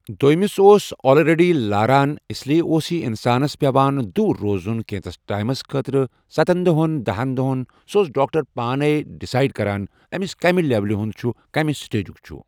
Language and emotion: Kashmiri, neutral